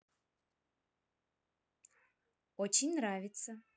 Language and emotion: Russian, positive